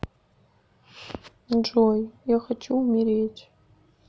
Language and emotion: Russian, sad